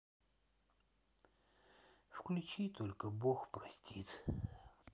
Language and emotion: Russian, sad